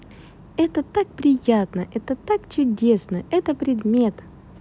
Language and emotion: Russian, positive